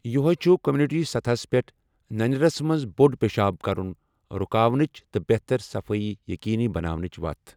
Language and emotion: Kashmiri, neutral